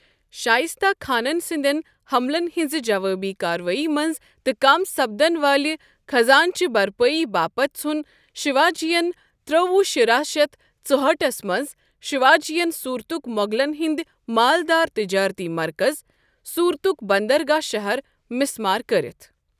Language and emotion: Kashmiri, neutral